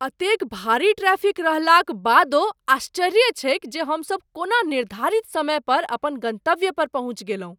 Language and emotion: Maithili, surprised